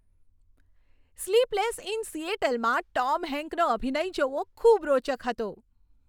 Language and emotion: Gujarati, happy